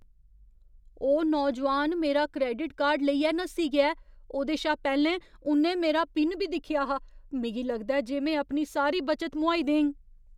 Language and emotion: Dogri, fearful